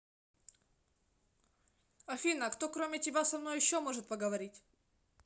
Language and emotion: Russian, neutral